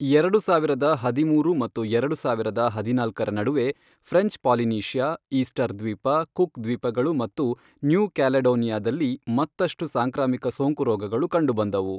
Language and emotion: Kannada, neutral